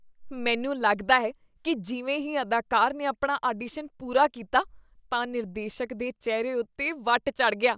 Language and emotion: Punjabi, disgusted